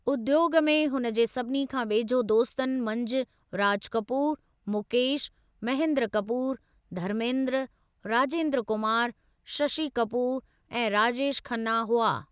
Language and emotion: Sindhi, neutral